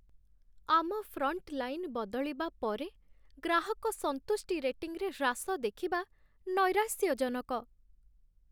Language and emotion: Odia, sad